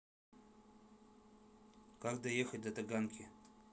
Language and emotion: Russian, neutral